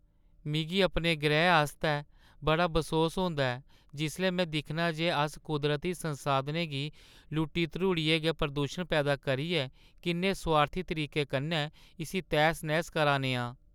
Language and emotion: Dogri, sad